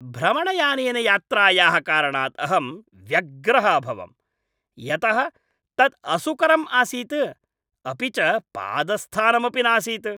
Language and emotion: Sanskrit, angry